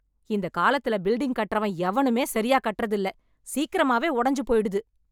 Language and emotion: Tamil, angry